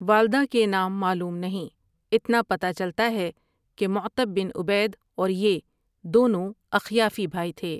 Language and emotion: Urdu, neutral